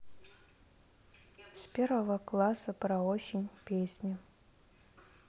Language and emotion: Russian, neutral